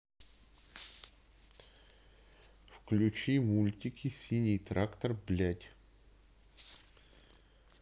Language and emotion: Russian, neutral